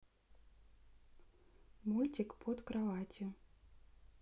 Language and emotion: Russian, neutral